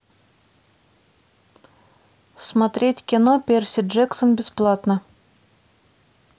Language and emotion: Russian, neutral